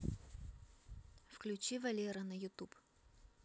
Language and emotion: Russian, neutral